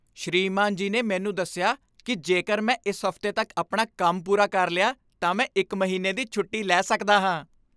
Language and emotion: Punjabi, happy